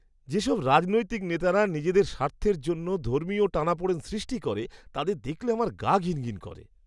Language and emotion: Bengali, disgusted